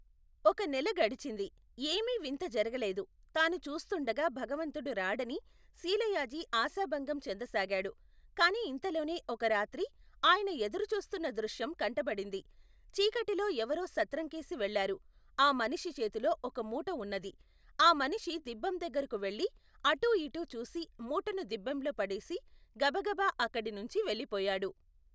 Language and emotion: Telugu, neutral